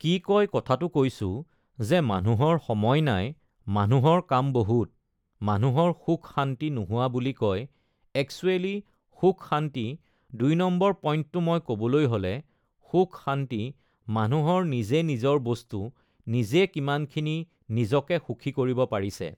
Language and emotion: Assamese, neutral